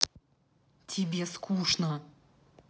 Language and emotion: Russian, angry